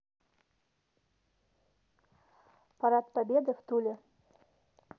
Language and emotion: Russian, neutral